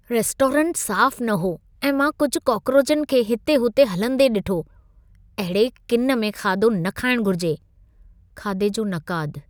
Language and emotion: Sindhi, disgusted